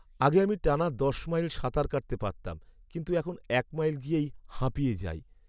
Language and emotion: Bengali, sad